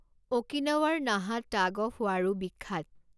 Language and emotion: Assamese, neutral